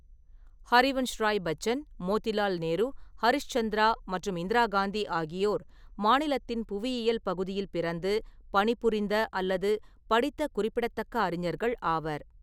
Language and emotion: Tamil, neutral